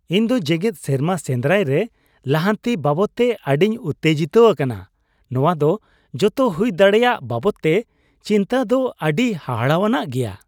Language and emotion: Santali, happy